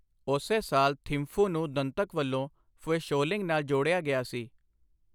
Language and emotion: Punjabi, neutral